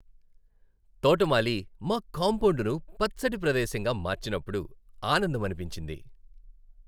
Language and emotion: Telugu, happy